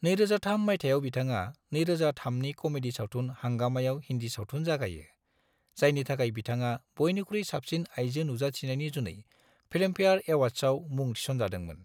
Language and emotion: Bodo, neutral